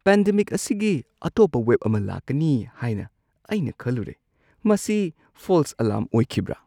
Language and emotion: Manipuri, surprised